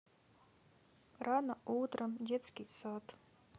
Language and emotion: Russian, sad